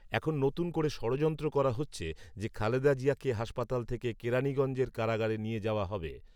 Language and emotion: Bengali, neutral